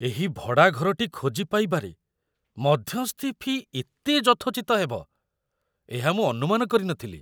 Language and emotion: Odia, surprised